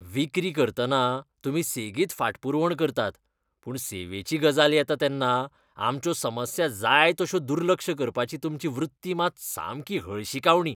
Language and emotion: Goan Konkani, disgusted